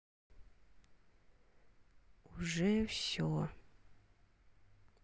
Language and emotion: Russian, sad